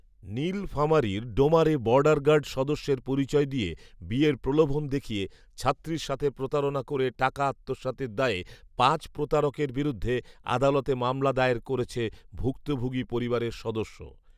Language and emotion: Bengali, neutral